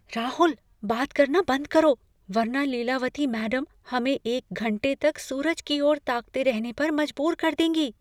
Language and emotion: Hindi, fearful